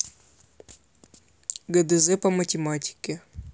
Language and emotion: Russian, neutral